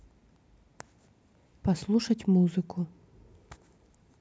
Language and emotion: Russian, neutral